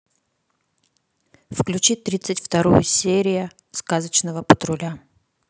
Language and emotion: Russian, neutral